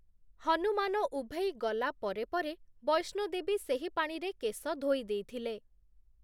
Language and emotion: Odia, neutral